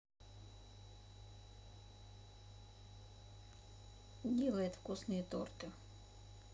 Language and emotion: Russian, neutral